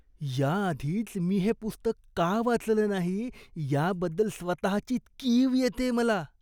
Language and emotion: Marathi, disgusted